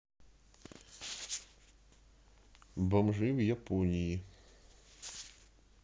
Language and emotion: Russian, neutral